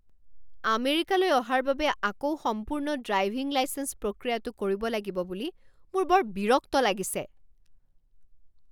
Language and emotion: Assamese, angry